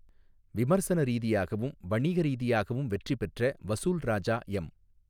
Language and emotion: Tamil, neutral